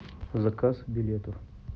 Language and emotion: Russian, neutral